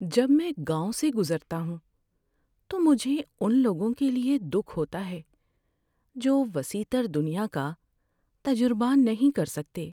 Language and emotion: Urdu, sad